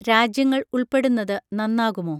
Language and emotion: Malayalam, neutral